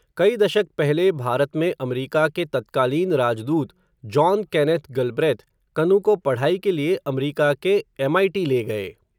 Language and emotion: Hindi, neutral